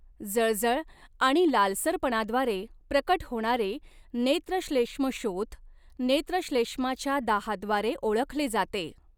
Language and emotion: Marathi, neutral